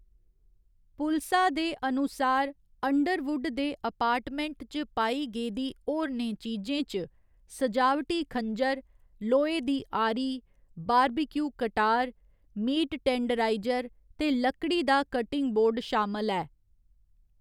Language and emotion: Dogri, neutral